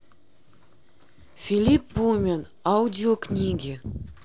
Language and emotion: Russian, neutral